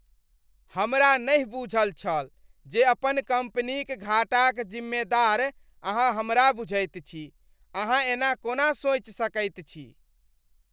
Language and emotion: Maithili, disgusted